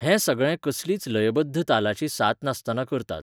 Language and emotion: Goan Konkani, neutral